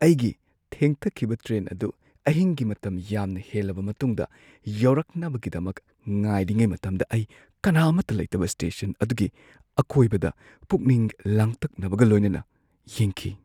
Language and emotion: Manipuri, fearful